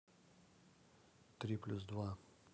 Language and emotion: Russian, neutral